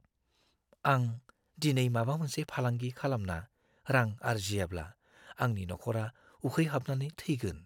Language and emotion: Bodo, fearful